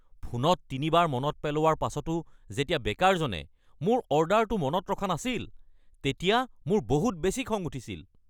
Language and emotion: Assamese, angry